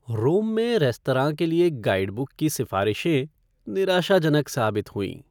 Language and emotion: Hindi, sad